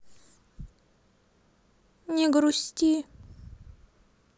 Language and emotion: Russian, sad